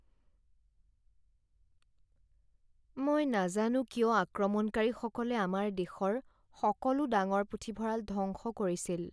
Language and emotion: Assamese, sad